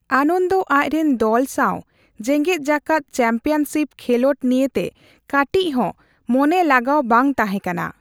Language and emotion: Santali, neutral